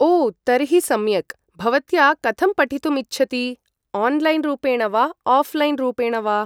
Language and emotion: Sanskrit, neutral